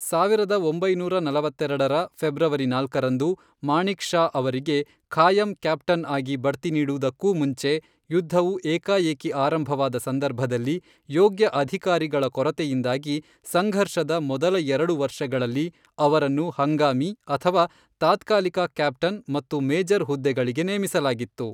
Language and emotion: Kannada, neutral